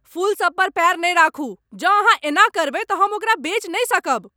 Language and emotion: Maithili, angry